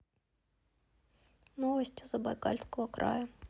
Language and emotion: Russian, sad